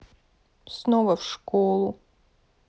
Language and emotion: Russian, sad